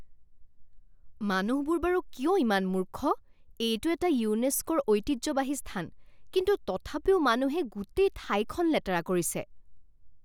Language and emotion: Assamese, angry